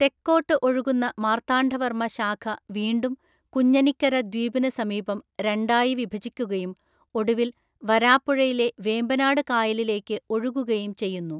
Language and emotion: Malayalam, neutral